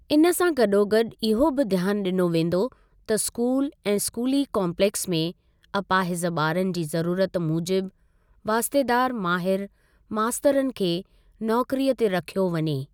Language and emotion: Sindhi, neutral